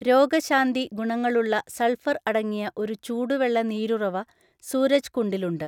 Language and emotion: Malayalam, neutral